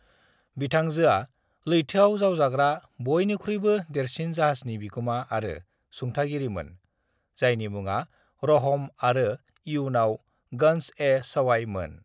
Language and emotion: Bodo, neutral